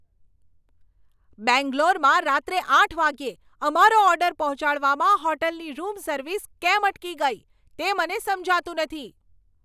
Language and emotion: Gujarati, angry